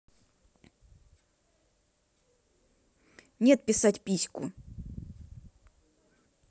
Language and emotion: Russian, angry